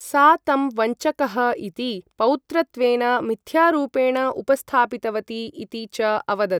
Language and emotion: Sanskrit, neutral